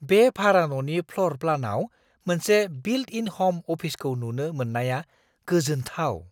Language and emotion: Bodo, surprised